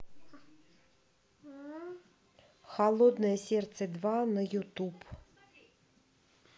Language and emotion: Russian, neutral